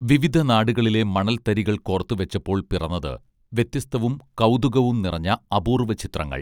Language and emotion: Malayalam, neutral